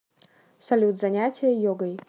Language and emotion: Russian, neutral